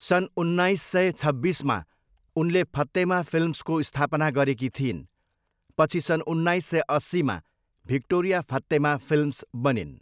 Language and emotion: Nepali, neutral